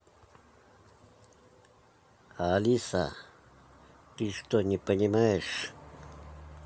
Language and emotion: Russian, angry